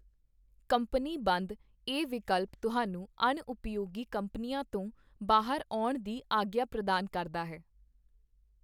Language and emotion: Punjabi, neutral